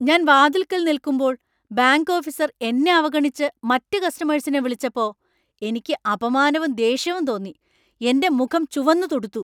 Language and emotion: Malayalam, angry